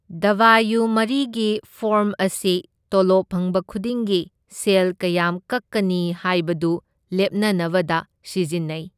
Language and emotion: Manipuri, neutral